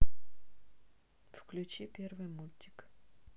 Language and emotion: Russian, neutral